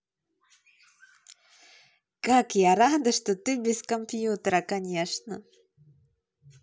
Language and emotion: Russian, positive